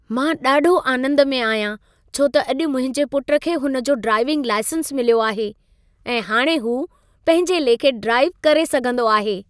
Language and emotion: Sindhi, happy